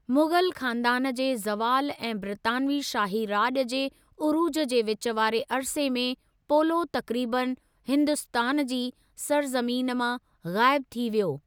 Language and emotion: Sindhi, neutral